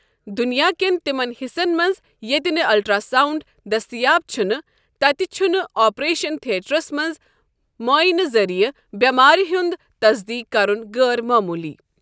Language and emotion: Kashmiri, neutral